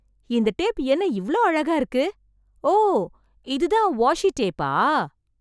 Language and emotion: Tamil, surprised